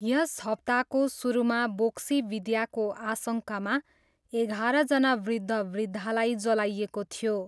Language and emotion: Nepali, neutral